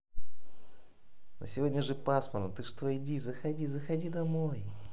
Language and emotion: Russian, positive